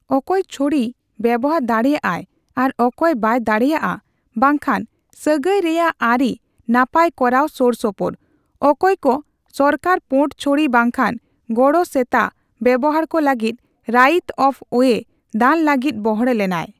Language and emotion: Santali, neutral